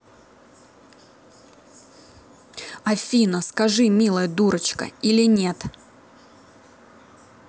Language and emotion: Russian, angry